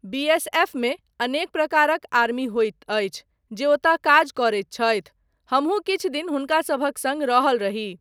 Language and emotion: Maithili, neutral